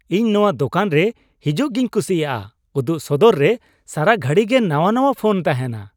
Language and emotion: Santali, happy